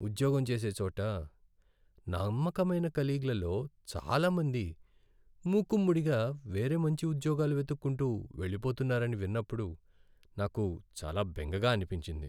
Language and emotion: Telugu, sad